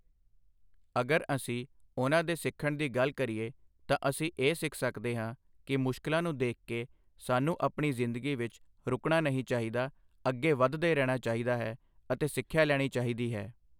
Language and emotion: Punjabi, neutral